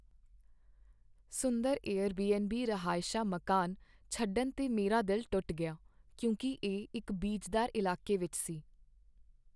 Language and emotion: Punjabi, sad